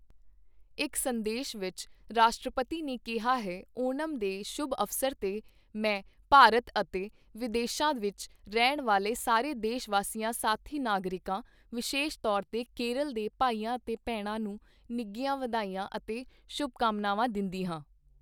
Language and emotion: Punjabi, neutral